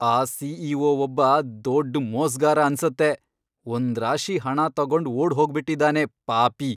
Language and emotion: Kannada, angry